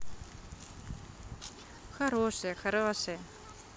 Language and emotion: Russian, positive